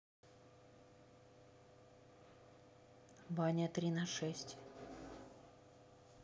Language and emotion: Russian, neutral